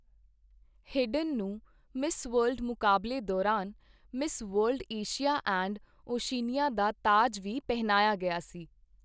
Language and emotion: Punjabi, neutral